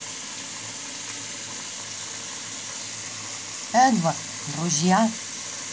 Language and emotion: Russian, neutral